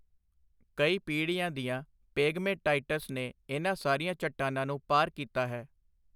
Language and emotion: Punjabi, neutral